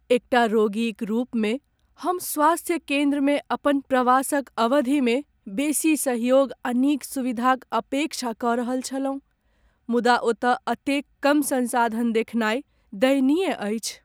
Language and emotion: Maithili, sad